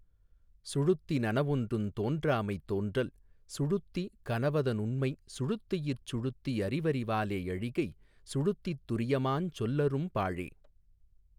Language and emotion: Tamil, neutral